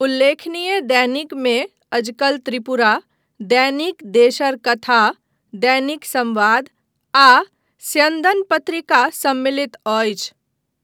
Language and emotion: Maithili, neutral